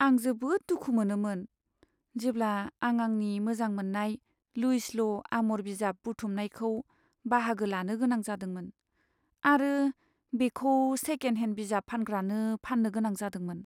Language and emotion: Bodo, sad